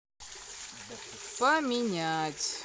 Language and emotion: Russian, neutral